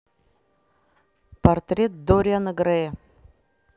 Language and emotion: Russian, neutral